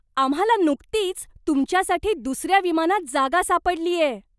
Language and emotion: Marathi, surprised